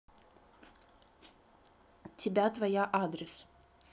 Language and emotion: Russian, neutral